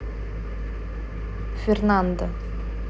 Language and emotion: Russian, neutral